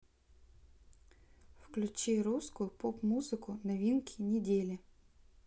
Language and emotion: Russian, neutral